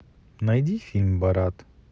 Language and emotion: Russian, neutral